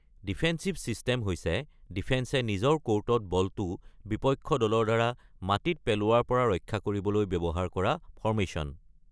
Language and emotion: Assamese, neutral